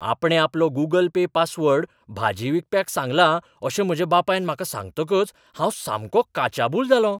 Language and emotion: Goan Konkani, surprised